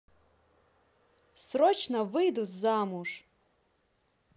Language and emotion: Russian, positive